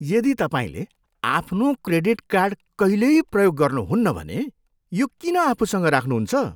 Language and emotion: Nepali, disgusted